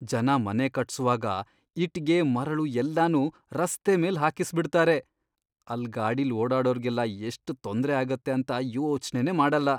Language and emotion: Kannada, disgusted